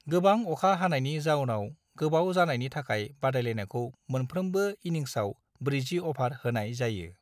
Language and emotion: Bodo, neutral